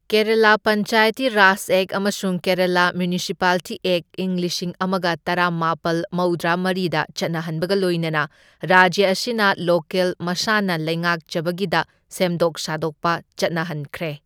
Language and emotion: Manipuri, neutral